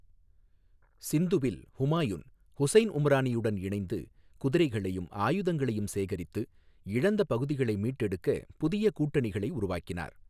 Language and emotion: Tamil, neutral